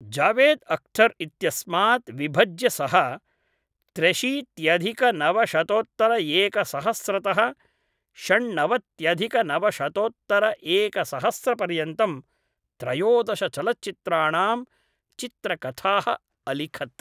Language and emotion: Sanskrit, neutral